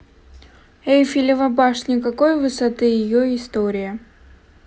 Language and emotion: Russian, neutral